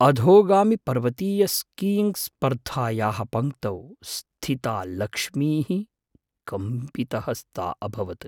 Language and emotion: Sanskrit, fearful